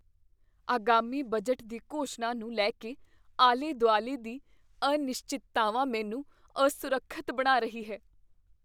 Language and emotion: Punjabi, fearful